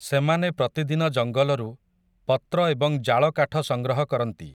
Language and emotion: Odia, neutral